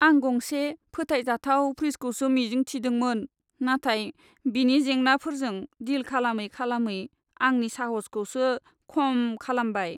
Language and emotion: Bodo, sad